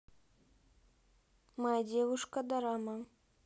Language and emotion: Russian, neutral